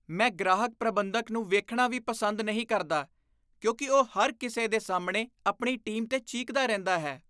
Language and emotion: Punjabi, disgusted